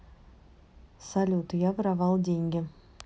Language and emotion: Russian, neutral